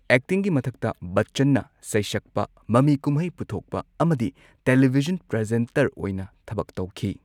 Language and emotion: Manipuri, neutral